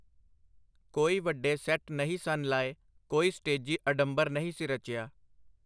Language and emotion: Punjabi, neutral